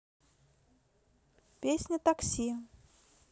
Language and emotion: Russian, neutral